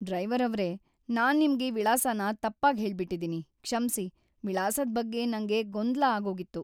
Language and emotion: Kannada, sad